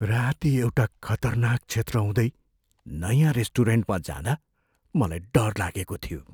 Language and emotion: Nepali, fearful